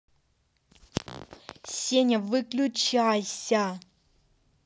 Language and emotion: Russian, angry